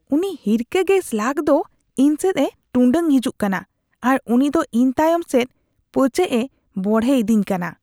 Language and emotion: Santali, disgusted